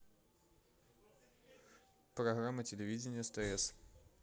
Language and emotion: Russian, neutral